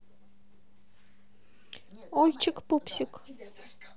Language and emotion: Russian, neutral